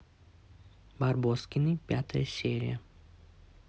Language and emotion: Russian, neutral